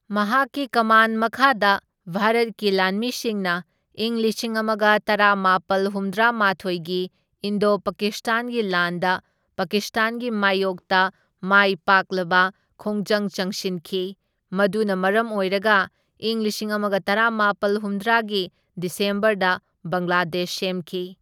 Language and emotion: Manipuri, neutral